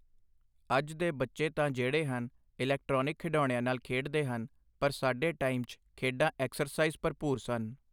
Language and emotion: Punjabi, neutral